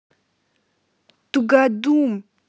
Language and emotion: Russian, angry